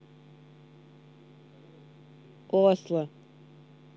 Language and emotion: Russian, neutral